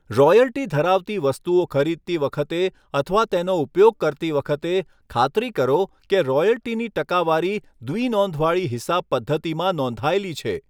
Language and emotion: Gujarati, neutral